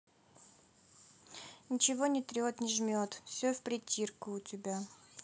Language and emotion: Russian, neutral